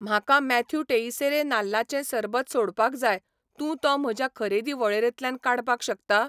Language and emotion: Goan Konkani, neutral